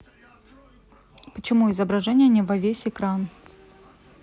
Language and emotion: Russian, neutral